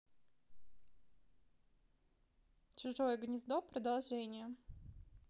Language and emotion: Russian, neutral